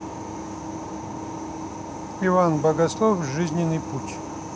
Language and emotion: Russian, neutral